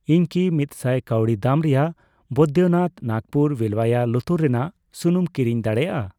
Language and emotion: Santali, neutral